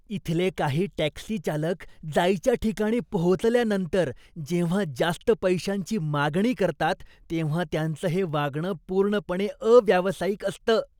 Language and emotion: Marathi, disgusted